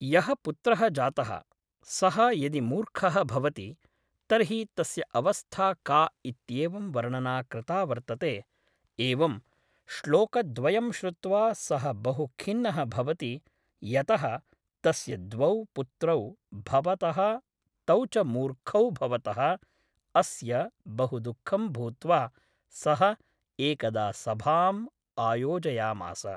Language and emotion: Sanskrit, neutral